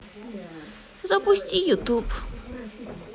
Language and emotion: Russian, sad